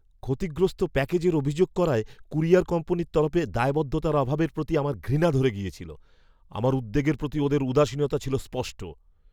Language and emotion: Bengali, disgusted